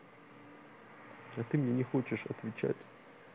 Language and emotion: Russian, sad